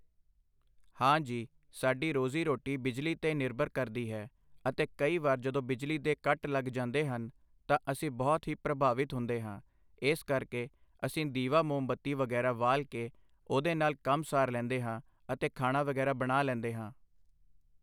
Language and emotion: Punjabi, neutral